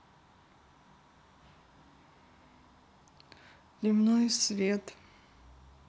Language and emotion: Russian, neutral